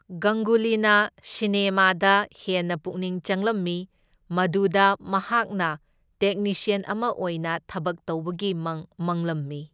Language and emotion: Manipuri, neutral